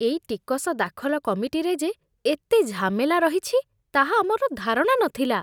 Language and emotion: Odia, disgusted